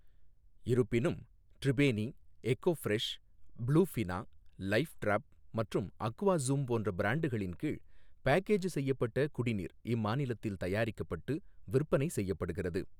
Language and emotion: Tamil, neutral